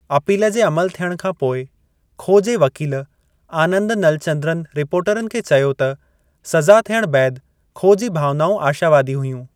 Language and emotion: Sindhi, neutral